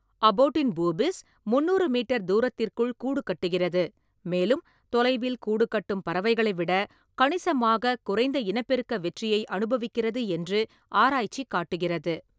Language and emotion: Tamil, neutral